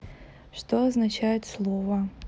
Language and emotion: Russian, neutral